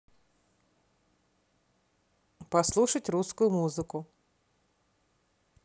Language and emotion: Russian, neutral